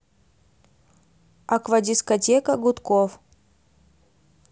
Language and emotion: Russian, neutral